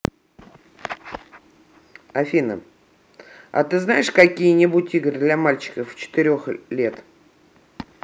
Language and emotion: Russian, neutral